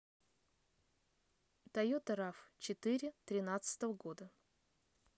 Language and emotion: Russian, neutral